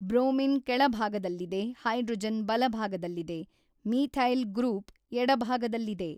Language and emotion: Kannada, neutral